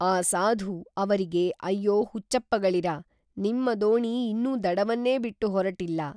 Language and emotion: Kannada, neutral